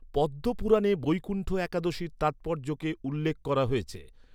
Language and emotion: Bengali, neutral